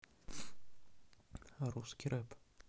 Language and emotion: Russian, neutral